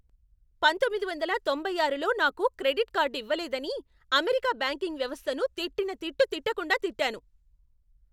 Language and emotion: Telugu, angry